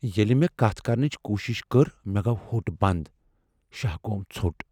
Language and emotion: Kashmiri, fearful